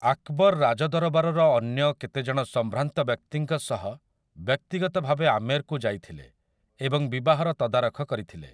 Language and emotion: Odia, neutral